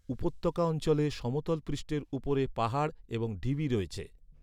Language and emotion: Bengali, neutral